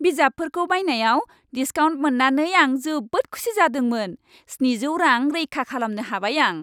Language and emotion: Bodo, happy